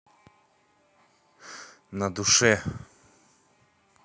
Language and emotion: Russian, neutral